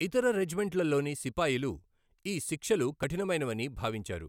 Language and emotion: Telugu, neutral